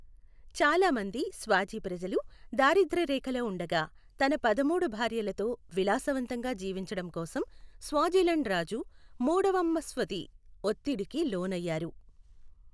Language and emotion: Telugu, neutral